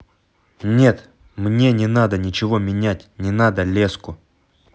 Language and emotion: Russian, angry